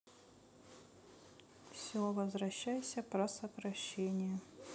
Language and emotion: Russian, sad